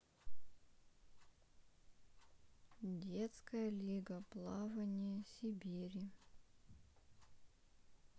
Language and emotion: Russian, neutral